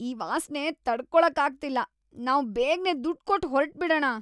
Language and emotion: Kannada, disgusted